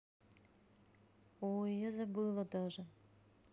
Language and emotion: Russian, neutral